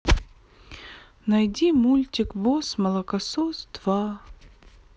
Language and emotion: Russian, sad